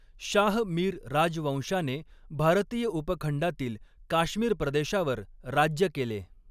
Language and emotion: Marathi, neutral